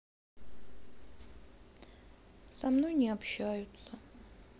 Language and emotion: Russian, sad